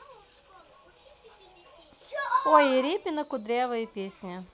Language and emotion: Russian, neutral